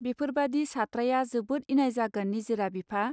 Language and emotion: Bodo, neutral